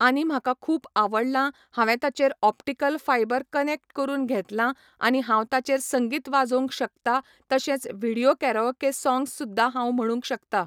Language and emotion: Goan Konkani, neutral